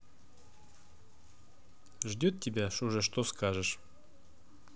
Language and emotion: Russian, neutral